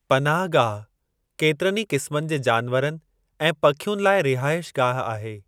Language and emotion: Sindhi, neutral